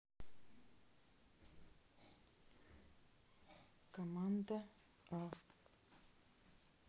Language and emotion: Russian, neutral